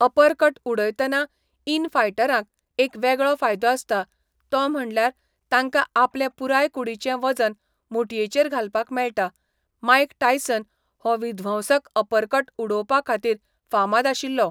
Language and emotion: Goan Konkani, neutral